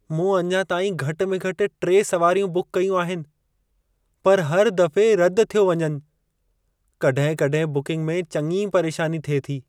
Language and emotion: Sindhi, sad